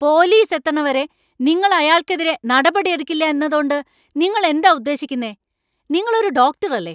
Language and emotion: Malayalam, angry